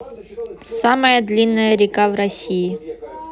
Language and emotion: Russian, neutral